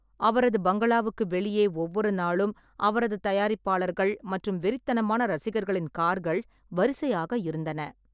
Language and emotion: Tamil, neutral